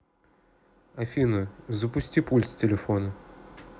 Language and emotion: Russian, neutral